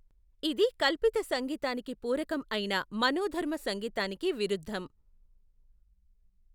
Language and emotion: Telugu, neutral